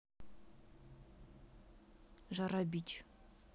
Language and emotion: Russian, neutral